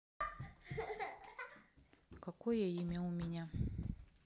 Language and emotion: Russian, neutral